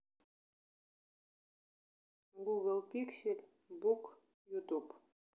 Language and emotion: Russian, neutral